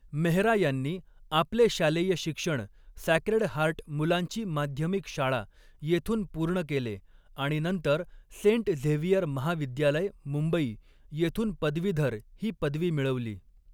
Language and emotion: Marathi, neutral